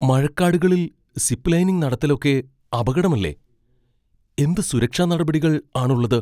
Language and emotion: Malayalam, fearful